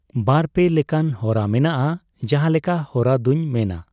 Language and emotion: Santali, neutral